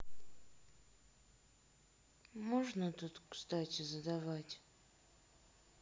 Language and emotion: Russian, sad